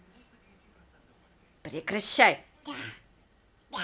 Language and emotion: Russian, angry